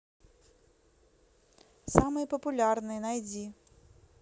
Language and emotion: Russian, neutral